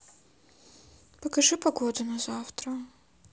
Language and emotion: Russian, neutral